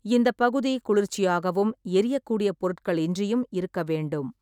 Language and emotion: Tamil, neutral